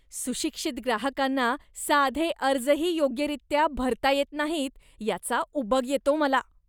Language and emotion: Marathi, disgusted